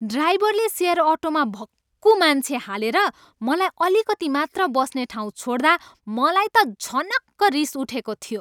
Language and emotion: Nepali, angry